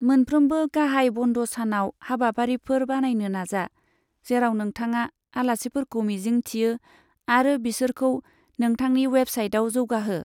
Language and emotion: Bodo, neutral